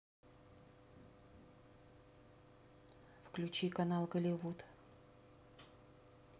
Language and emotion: Russian, neutral